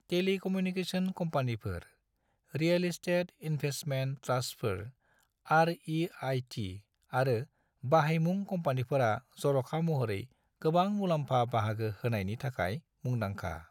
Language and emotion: Bodo, neutral